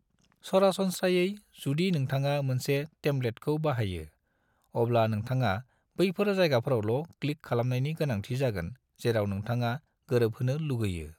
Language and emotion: Bodo, neutral